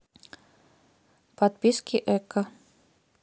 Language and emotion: Russian, neutral